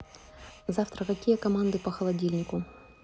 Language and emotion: Russian, neutral